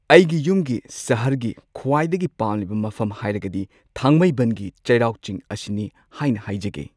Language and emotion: Manipuri, neutral